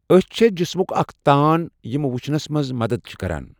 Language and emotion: Kashmiri, neutral